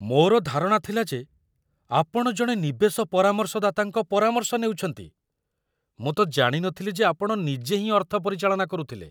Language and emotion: Odia, surprised